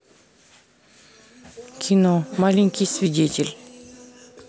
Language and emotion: Russian, neutral